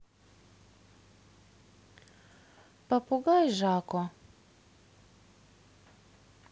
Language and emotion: Russian, neutral